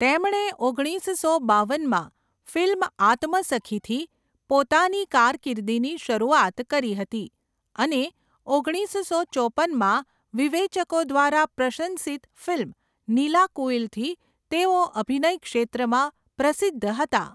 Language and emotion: Gujarati, neutral